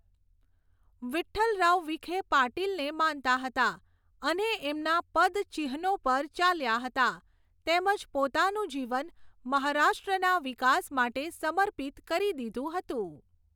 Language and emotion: Gujarati, neutral